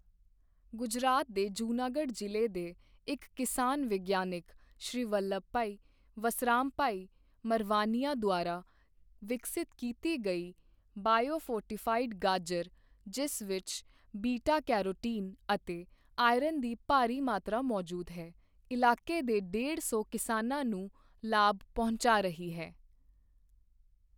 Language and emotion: Punjabi, neutral